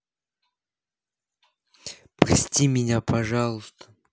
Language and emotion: Russian, sad